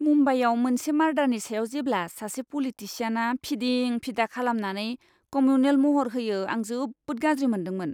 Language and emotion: Bodo, disgusted